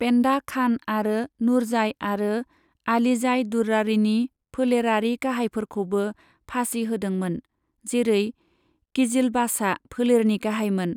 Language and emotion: Bodo, neutral